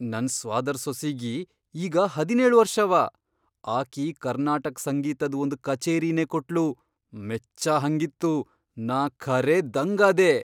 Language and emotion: Kannada, surprised